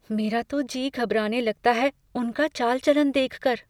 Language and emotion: Hindi, fearful